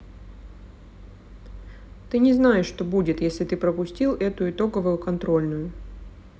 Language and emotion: Russian, neutral